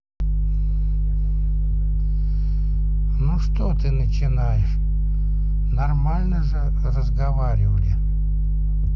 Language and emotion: Russian, neutral